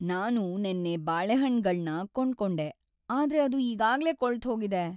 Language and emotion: Kannada, sad